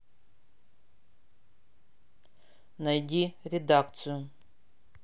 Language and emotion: Russian, neutral